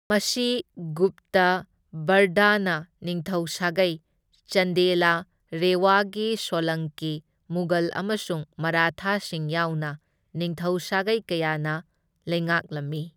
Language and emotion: Manipuri, neutral